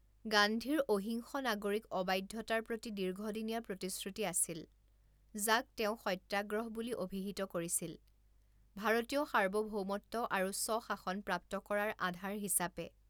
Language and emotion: Assamese, neutral